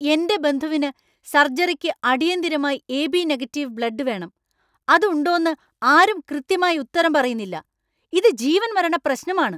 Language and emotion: Malayalam, angry